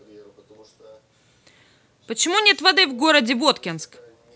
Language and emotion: Russian, angry